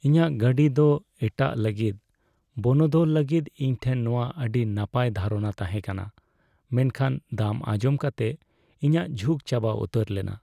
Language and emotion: Santali, sad